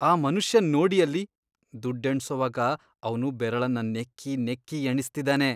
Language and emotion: Kannada, disgusted